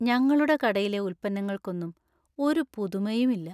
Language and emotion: Malayalam, sad